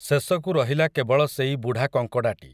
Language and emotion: Odia, neutral